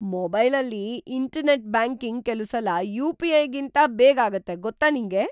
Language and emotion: Kannada, surprised